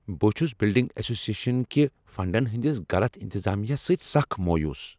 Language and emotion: Kashmiri, angry